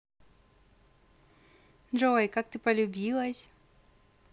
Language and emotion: Russian, positive